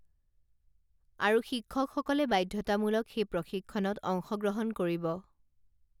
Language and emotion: Assamese, neutral